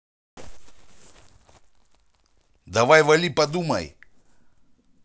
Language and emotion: Russian, angry